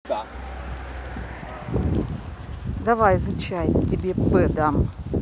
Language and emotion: Russian, neutral